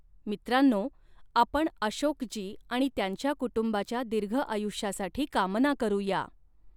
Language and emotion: Marathi, neutral